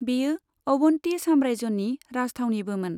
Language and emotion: Bodo, neutral